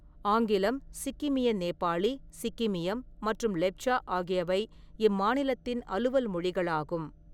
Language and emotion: Tamil, neutral